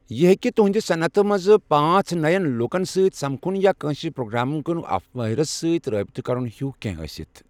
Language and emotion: Kashmiri, neutral